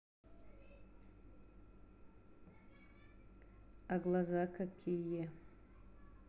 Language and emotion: Russian, neutral